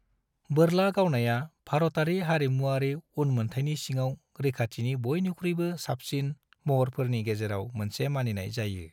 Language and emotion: Bodo, neutral